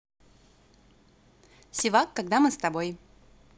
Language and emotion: Russian, positive